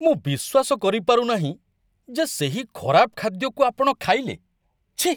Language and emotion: Odia, disgusted